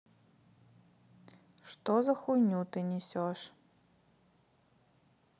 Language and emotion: Russian, neutral